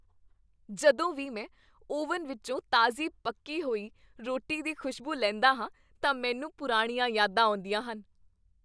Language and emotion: Punjabi, happy